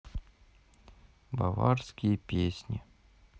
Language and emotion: Russian, sad